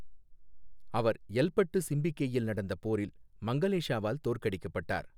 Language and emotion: Tamil, neutral